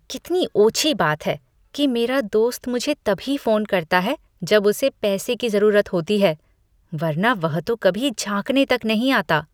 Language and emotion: Hindi, disgusted